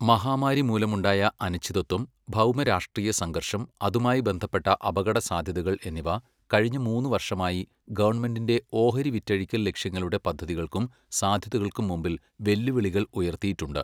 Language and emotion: Malayalam, neutral